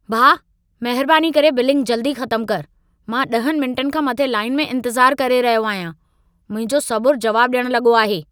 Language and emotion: Sindhi, angry